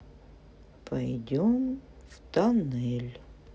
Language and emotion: Russian, sad